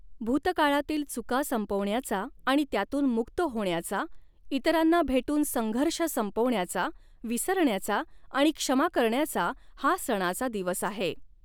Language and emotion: Marathi, neutral